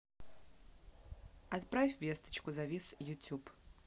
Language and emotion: Russian, neutral